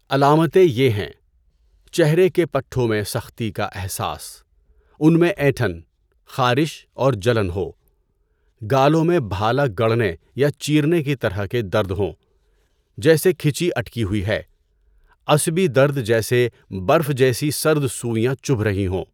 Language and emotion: Urdu, neutral